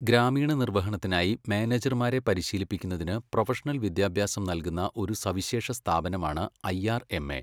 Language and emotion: Malayalam, neutral